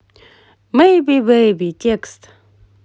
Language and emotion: Russian, positive